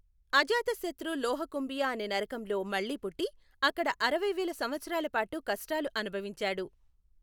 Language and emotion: Telugu, neutral